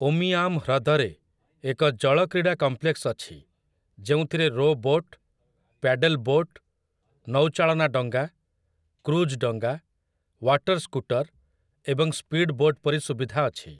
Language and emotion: Odia, neutral